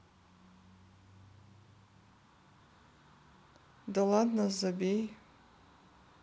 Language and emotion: Russian, neutral